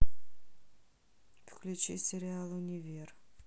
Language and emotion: Russian, neutral